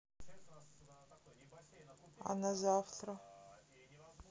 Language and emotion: Russian, neutral